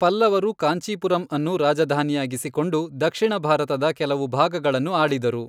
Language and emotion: Kannada, neutral